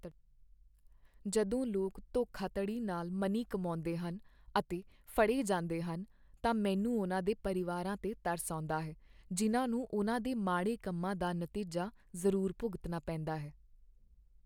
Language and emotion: Punjabi, sad